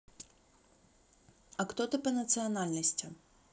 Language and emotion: Russian, neutral